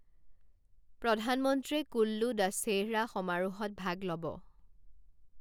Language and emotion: Assamese, neutral